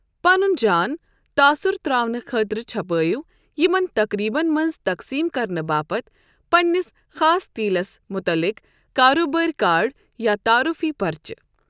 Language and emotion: Kashmiri, neutral